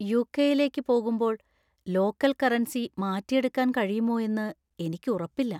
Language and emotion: Malayalam, fearful